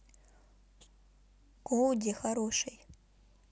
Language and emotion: Russian, neutral